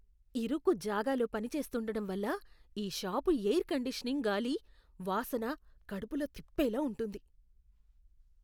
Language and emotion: Telugu, disgusted